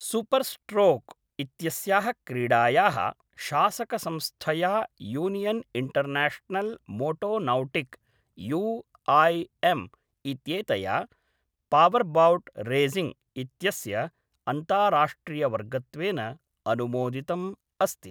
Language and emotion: Sanskrit, neutral